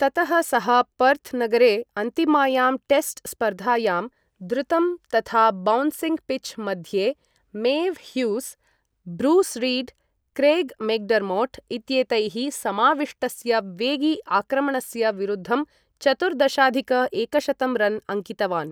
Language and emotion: Sanskrit, neutral